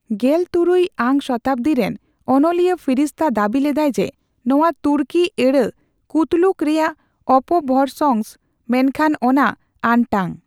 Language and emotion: Santali, neutral